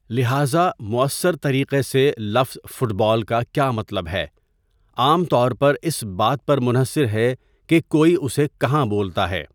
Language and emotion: Urdu, neutral